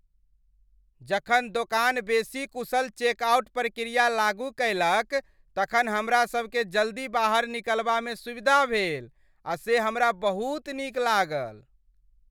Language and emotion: Maithili, happy